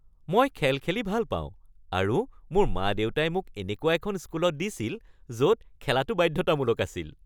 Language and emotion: Assamese, happy